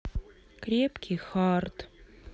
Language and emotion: Russian, sad